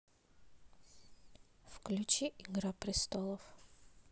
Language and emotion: Russian, neutral